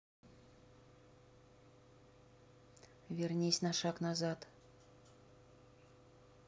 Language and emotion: Russian, neutral